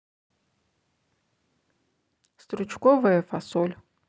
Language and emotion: Russian, neutral